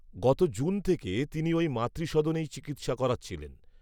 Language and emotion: Bengali, neutral